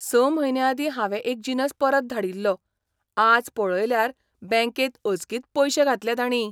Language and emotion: Goan Konkani, surprised